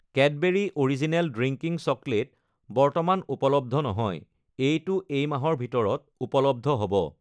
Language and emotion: Assamese, neutral